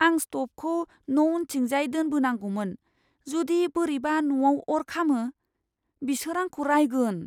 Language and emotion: Bodo, fearful